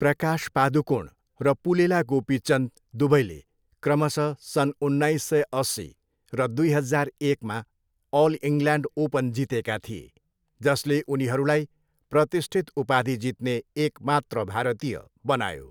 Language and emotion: Nepali, neutral